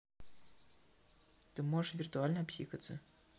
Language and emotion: Russian, neutral